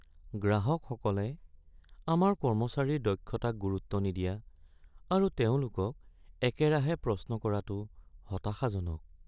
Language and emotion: Assamese, sad